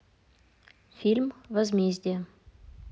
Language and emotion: Russian, neutral